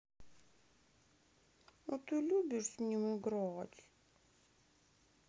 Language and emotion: Russian, sad